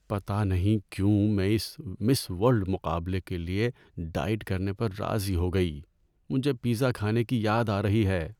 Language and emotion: Urdu, sad